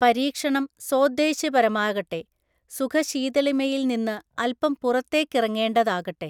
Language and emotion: Malayalam, neutral